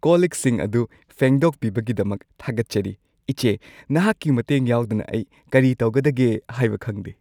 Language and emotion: Manipuri, happy